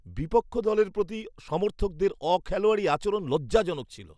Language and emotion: Bengali, disgusted